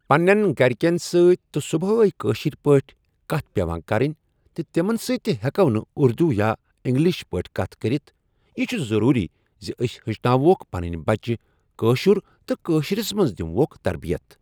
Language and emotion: Kashmiri, neutral